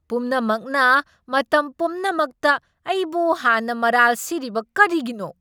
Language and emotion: Manipuri, angry